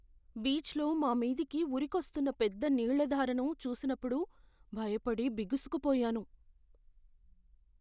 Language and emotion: Telugu, fearful